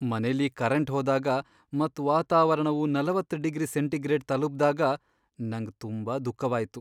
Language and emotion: Kannada, sad